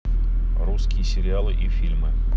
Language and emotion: Russian, neutral